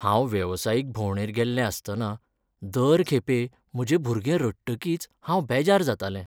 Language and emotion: Goan Konkani, sad